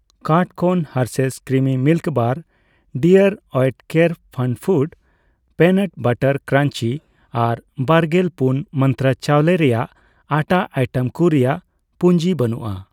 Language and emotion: Santali, neutral